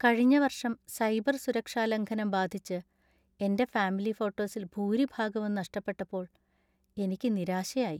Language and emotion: Malayalam, sad